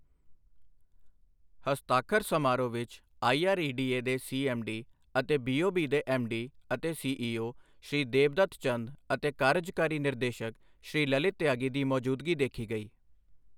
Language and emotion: Punjabi, neutral